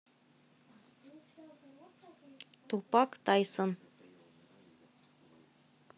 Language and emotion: Russian, neutral